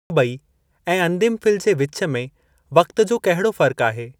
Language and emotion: Sindhi, neutral